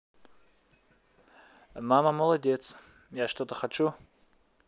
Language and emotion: Russian, neutral